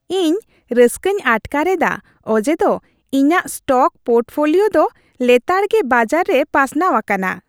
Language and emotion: Santali, happy